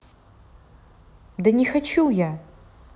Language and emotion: Russian, angry